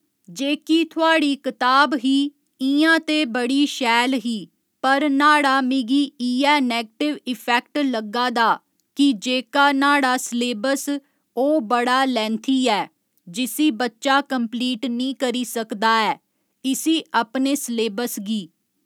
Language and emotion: Dogri, neutral